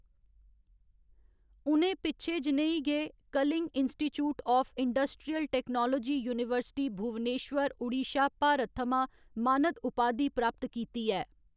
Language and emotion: Dogri, neutral